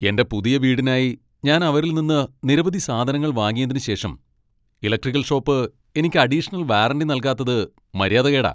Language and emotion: Malayalam, angry